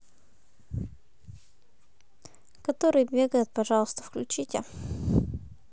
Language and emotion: Russian, neutral